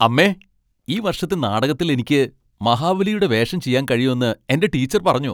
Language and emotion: Malayalam, happy